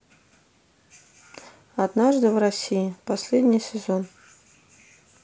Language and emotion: Russian, neutral